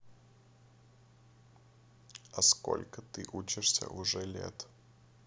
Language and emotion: Russian, neutral